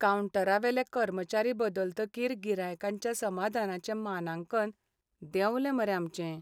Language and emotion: Goan Konkani, sad